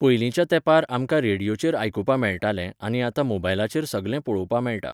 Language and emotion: Goan Konkani, neutral